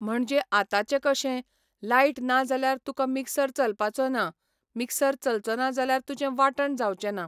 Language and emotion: Goan Konkani, neutral